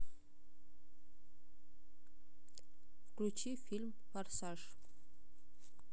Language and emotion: Russian, neutral